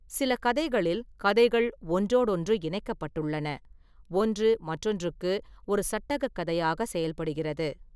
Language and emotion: Tamil, neutral